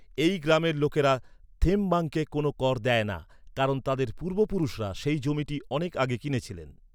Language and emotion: Bengali, neutral